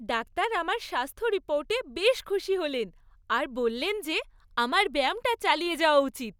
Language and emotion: Bengali, happy